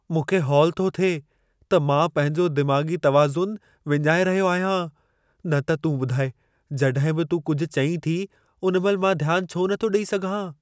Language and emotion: Sindhi, fearful